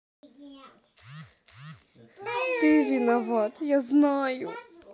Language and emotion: Russian, sad